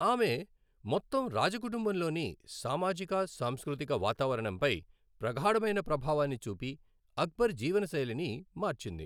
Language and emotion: Telugu, neutral